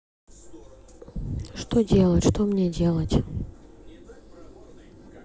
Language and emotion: Russian, neutral